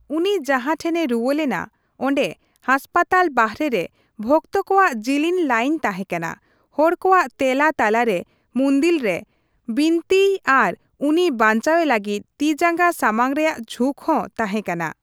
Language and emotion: Santali, neutral